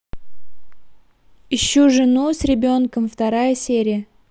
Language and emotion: Russian, neutral